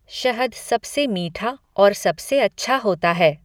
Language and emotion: Hindi, neutral